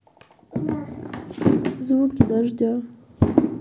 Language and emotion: Russian, sad